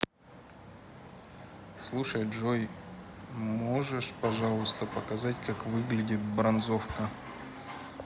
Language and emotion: Russian, neutral